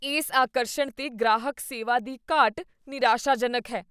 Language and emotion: Punjabi, disgusted